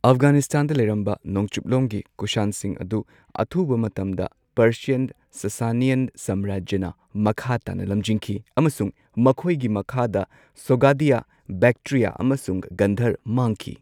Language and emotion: Manipuri, neutral